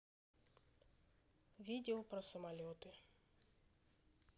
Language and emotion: Russian, neutral